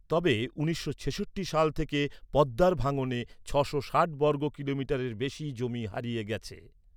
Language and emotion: Bengali, neutral